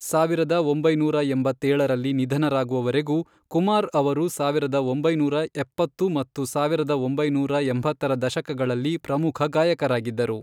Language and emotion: Kannada, neutral